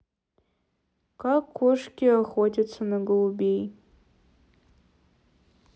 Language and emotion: Russian, sad